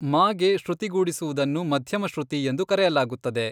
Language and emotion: Kannada, neutral